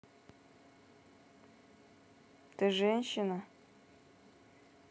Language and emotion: Russian, neutral